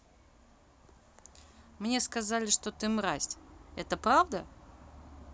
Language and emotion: Russian, neutral